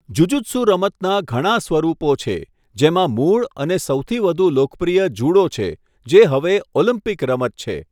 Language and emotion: Gujarati, neutral